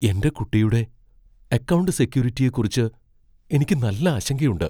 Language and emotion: Malayalam, fearful